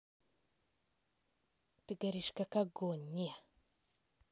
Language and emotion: Russian, positive